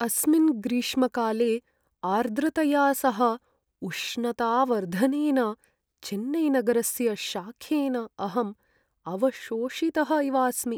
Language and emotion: Sanskrit, sad